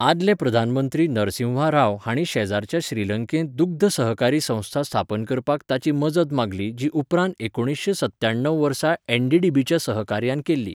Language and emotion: Goan Konkani, neutral